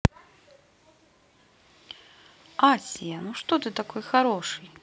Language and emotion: Russian, positive